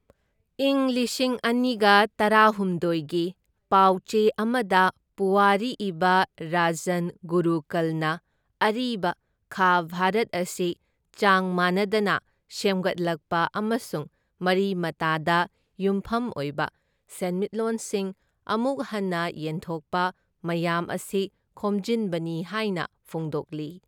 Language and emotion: Manipuri, neutral